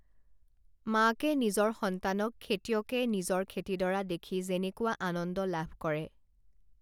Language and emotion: Assamese, neutral